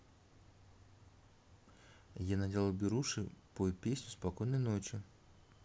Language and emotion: Russian, neutral